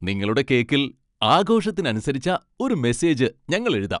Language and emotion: Malayalam, happy